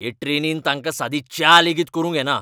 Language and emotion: Goan Konkani, angry